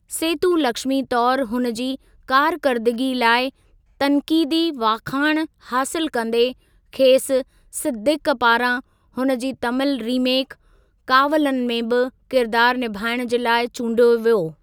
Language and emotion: Sindhi, neutral